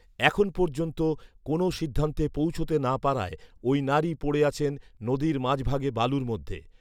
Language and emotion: Bengali, neutral